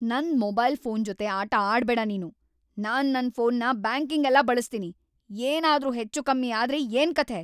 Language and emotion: Kannada, angry